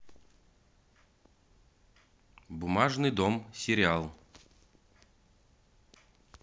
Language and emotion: Russian, neutral